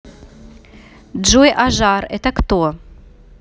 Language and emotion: Russian, neutral